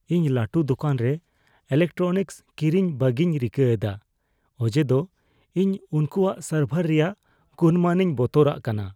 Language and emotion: Santali, fearful